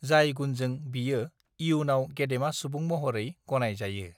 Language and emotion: Bodo, neutral